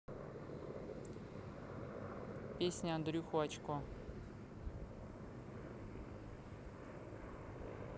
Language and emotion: Russian, neutral